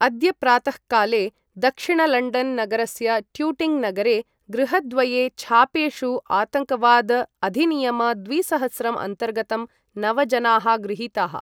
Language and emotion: Sanskrit, neutral